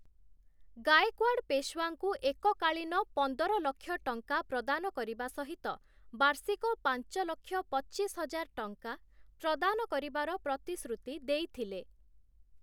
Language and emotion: Odia, neutral